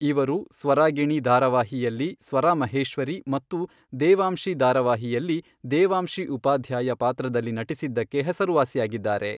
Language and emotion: Kannada, neutral